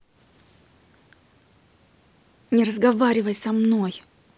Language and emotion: Russian, angry